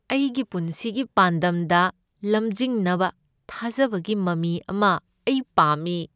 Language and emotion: Manipuri, sad